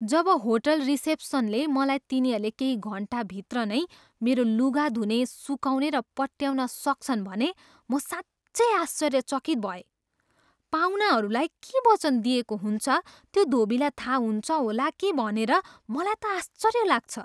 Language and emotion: Nepali, surprised